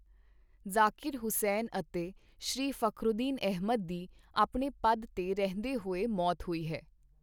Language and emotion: Punjabi, neutral